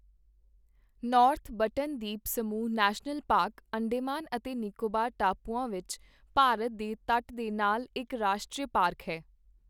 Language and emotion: Punjabi, neutral